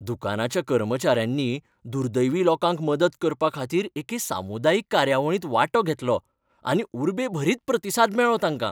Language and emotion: Goan Konkani, happy